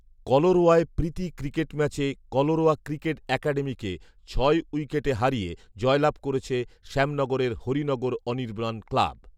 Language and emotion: Bengali, neutral